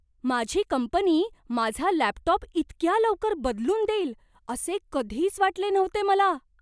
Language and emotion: Marathi, surprised